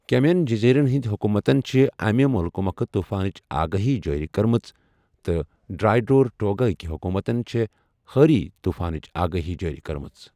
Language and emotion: Kashmiri, neutral